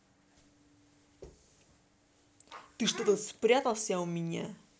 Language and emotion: Russian, angry